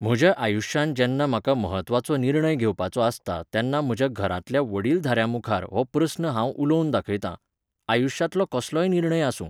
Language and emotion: Goan Konkani, neutral